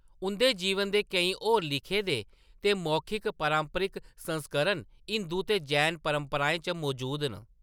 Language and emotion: Dogri, neutral